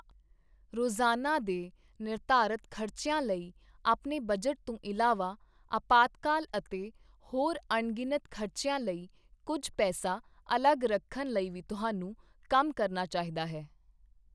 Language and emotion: Punjabi, neutral